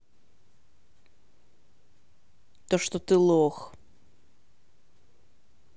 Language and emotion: Russian, angry